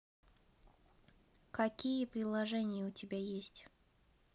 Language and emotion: Russian, neutral